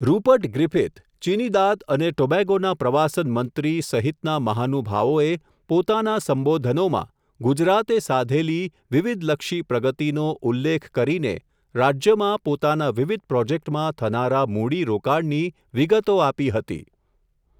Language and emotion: Gujarati, neutral